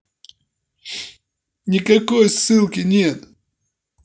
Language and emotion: Russian, angry